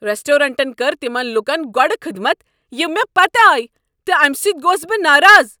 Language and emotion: Kashmiri, angry